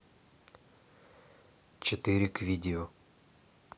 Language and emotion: Russian, neutral